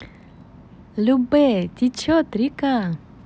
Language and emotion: Russian, positive